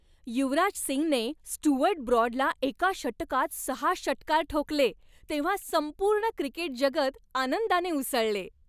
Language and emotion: Marathi, happy